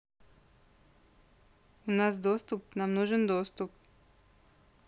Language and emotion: Russian, neutral